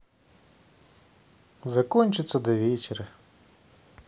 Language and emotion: Russian, neutral